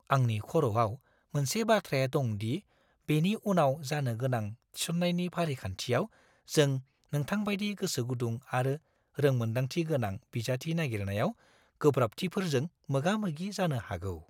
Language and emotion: Bodo, fearful